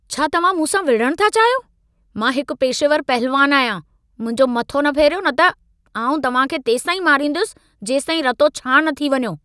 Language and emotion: Sindhi, angry